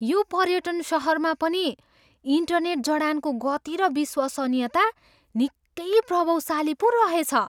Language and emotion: Nepali, surprised